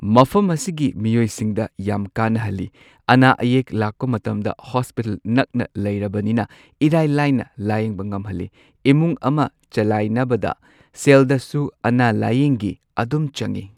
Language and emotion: Manipuri, neutral